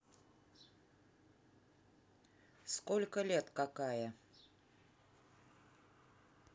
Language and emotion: Russian, neutral